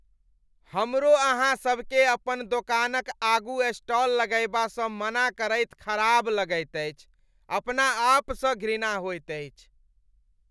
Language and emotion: Maithili, disgusted